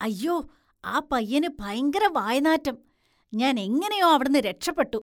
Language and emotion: Malayalam, disgusted